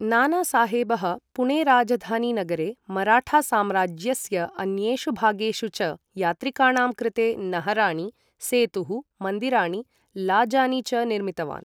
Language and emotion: Sanskrit, neutral